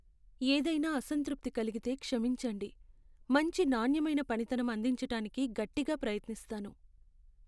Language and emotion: Telugu, sad